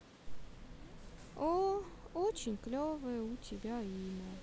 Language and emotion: Russian, sad